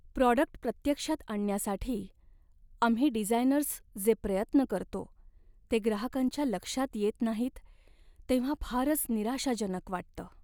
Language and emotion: Marathi, sad